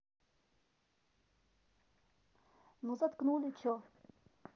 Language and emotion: Russian, neutral